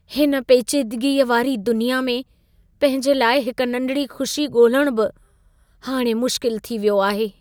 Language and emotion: Sindhi, sad